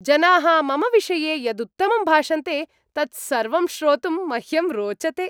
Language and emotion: Sanskrit, happy